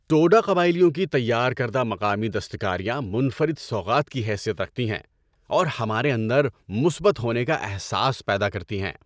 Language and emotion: Urdu, happy